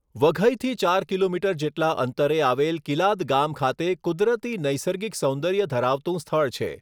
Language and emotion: Gujarati, neutral